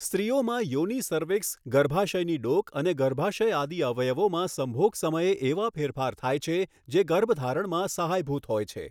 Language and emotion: Gujarati, neutral